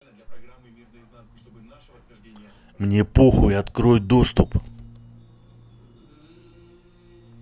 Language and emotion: Russian, angry